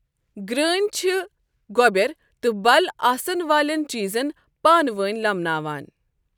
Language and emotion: Kashmiri, neutral